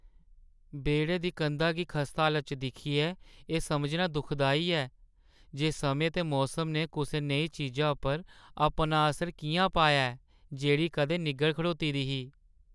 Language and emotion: Dogri, sad